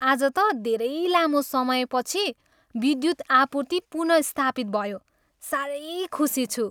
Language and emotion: Nepali, happy